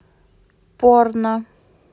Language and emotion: Russian, neutral